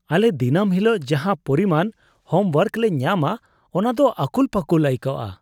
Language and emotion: Santali, disgusted